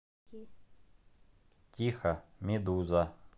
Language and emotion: Russian, neutral